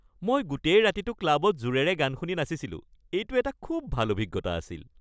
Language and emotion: Assamese, happy